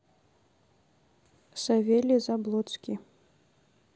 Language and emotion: Russian, neutral